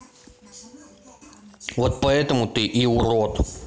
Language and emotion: Russian, angry